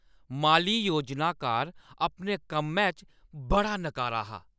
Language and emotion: Dogri, angry